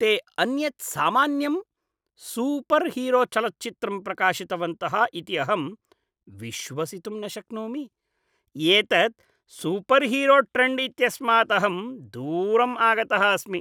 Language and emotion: Sanskrit, disgusted